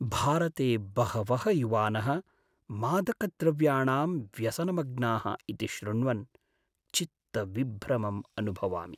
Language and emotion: Sanskrit, sad